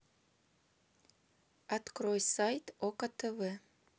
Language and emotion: Russian, neutral